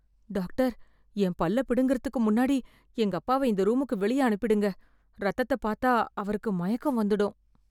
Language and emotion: Tamil, fearful